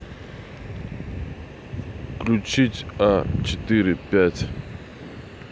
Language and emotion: Russian, neutral